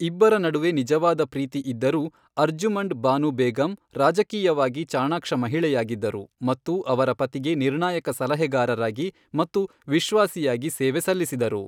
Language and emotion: Kannada, neutral